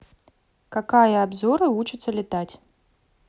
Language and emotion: Russian, neutral